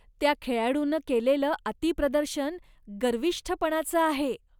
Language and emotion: Marathi, disgusted